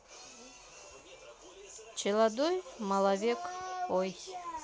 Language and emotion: Russian, neutral